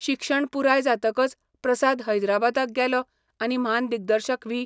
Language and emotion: Goan Konkani, neutral